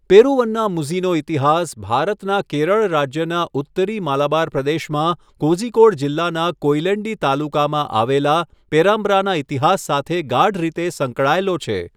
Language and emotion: Gujarati, neutral